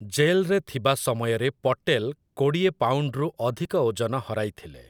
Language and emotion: Odia, neutral